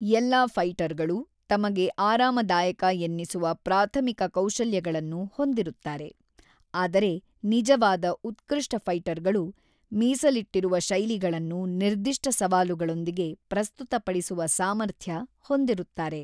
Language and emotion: Kannada, neutral